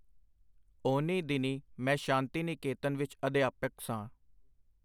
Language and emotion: Punjabi, neutral